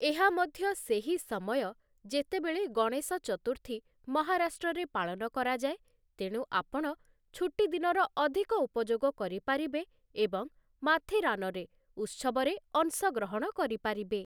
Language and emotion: Odia, neutral